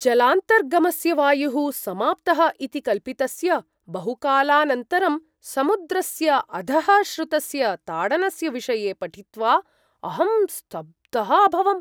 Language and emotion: Sanskrit, surprised